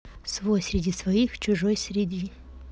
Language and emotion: Russian, neutral